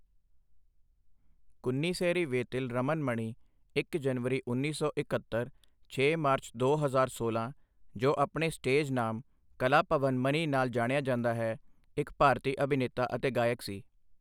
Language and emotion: Punjabi, neutral